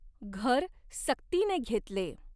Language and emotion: Marathi, neutral